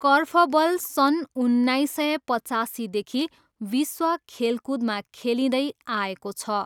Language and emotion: Nepali, neutral